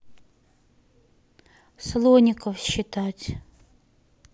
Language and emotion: Russian, neutral